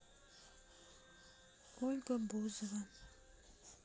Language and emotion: Russian, sad